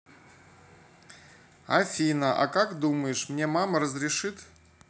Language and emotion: Russian, neutral